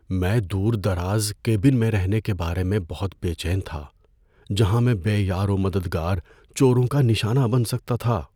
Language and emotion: Urdu, fearful